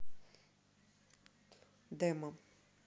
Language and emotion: Russian, neutral